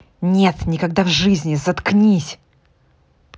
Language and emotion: Russian, angry